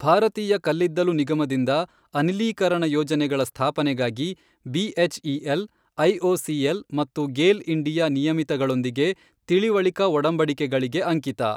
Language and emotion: Kannada, neutral